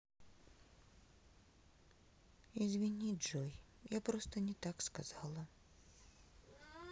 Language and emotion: Russian, sad